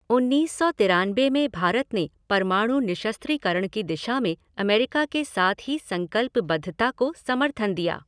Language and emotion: Hindi, neutral